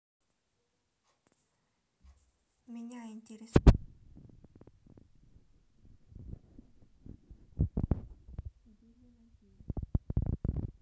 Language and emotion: Russian, neutral